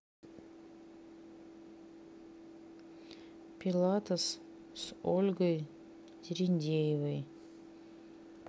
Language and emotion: Russian, neutral